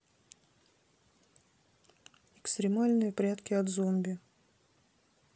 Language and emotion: Russian, neutral